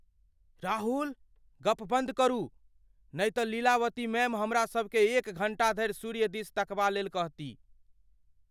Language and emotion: Maithili, fearful